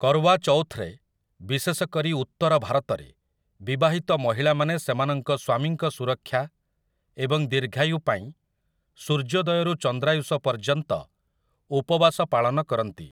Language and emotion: Odia, neutral